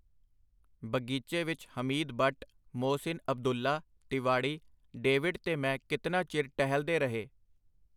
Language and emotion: Punjabi, neutral